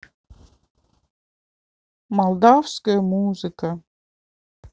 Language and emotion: Russian, neutral